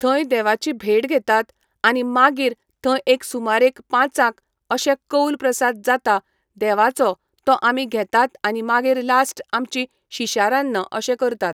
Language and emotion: Goan Konkani, neutral